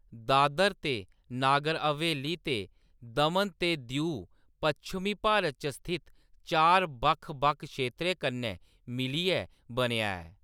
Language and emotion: Dogri, neutral